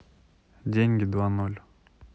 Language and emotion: Russian, neutral